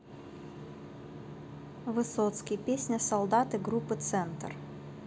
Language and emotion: Russian, neutral